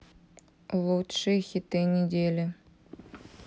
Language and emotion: Russian, neutral